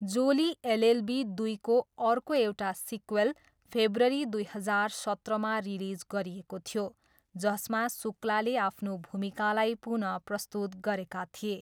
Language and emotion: Nepali, neutral